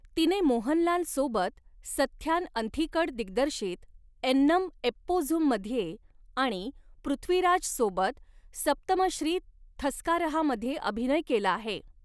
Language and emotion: Marathi, neutral